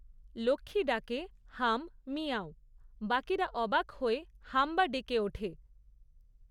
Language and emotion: Bengali, neutral